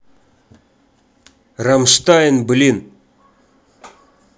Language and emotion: Russian, neutral